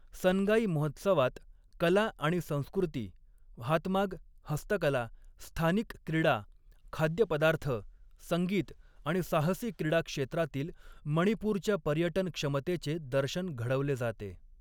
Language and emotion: Marathi, neutral